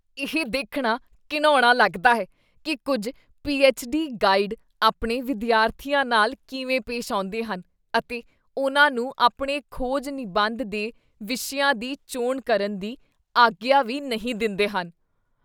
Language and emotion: Punjabi, disgusted